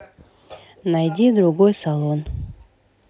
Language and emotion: Russian, neutral